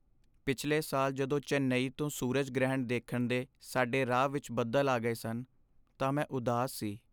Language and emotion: Punjabi, sad